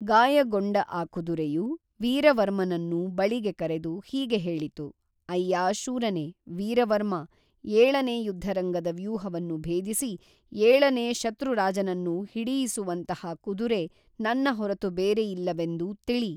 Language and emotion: Kannada, neutral